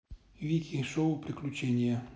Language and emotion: Russian, neutral